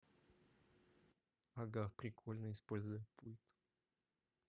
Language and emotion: Russian, neutral